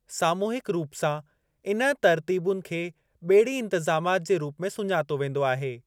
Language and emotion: Sindhi, neutral